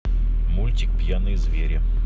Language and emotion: Russian, neutral